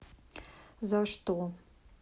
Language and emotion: Russian, neutral